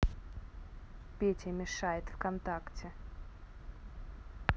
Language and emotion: Russian, neutral